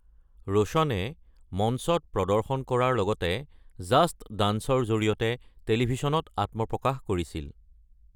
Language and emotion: Assamese, neutral